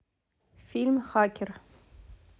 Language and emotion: Russian, neutral